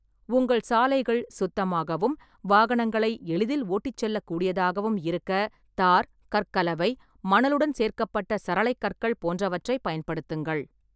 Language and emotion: Tamil, neutral